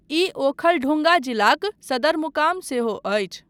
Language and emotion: Maithili, neutral